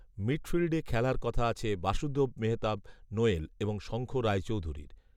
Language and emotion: Bengali, neutral